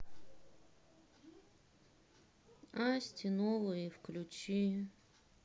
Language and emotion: Russian, sad